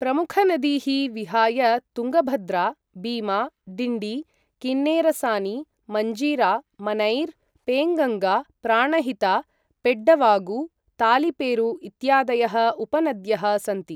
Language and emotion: Sanskrit, neutral